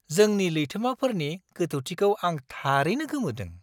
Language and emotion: Bodo, surprised